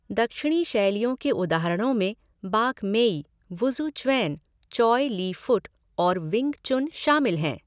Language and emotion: Hindi, neutral